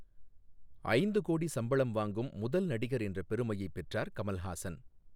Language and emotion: Tamil, neutral